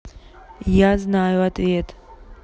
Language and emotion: Russian, neutral